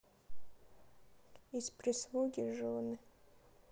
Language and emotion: Russian, sad